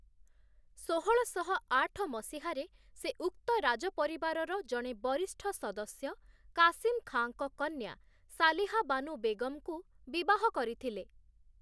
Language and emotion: Odia, neutral